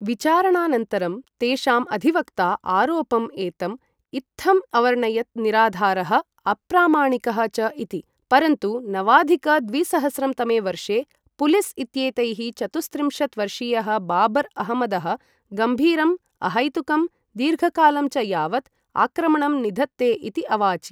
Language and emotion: Sanskrit, neutral